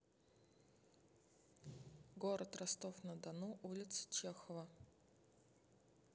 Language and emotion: Russian, neutral